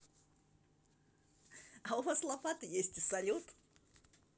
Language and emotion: Russian, positive